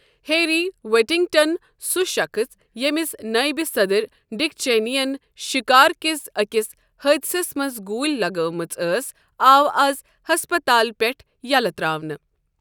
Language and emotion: Kashmiri, neutral